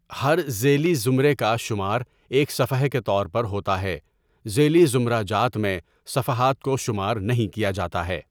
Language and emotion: Urdu, neutral